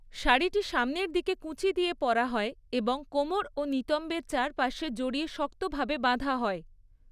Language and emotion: Bengali, neutral